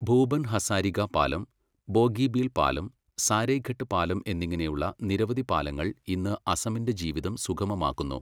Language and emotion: Malayalam, neutral